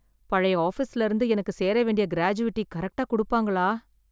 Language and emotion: Tamil, fearful